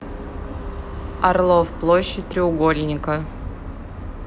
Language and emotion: Russian, neutral